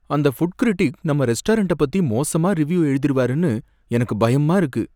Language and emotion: Tamil, fearful